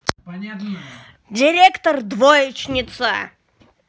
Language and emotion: Russian, angry